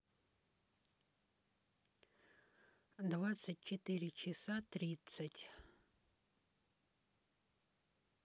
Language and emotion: Russian, neutral